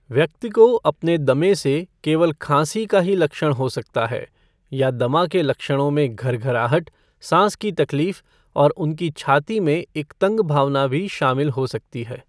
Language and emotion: Hindi, neutral